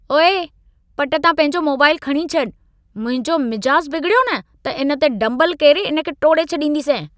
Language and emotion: Sindhi, angry